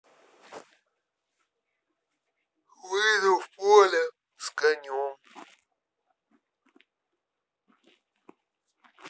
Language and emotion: Russian, neutral